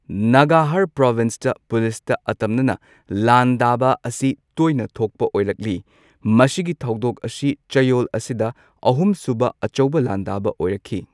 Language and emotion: Manipuri, neutral